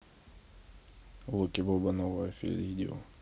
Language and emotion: Russian, neutral